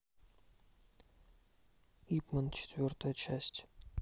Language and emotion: Russian, neutral